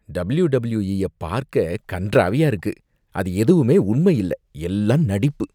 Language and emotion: Tamil, disgusted